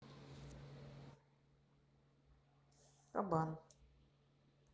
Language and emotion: Russian, neutral